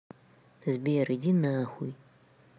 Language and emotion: Russian, neutral